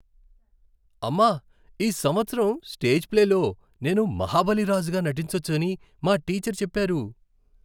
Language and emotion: Telugu, happy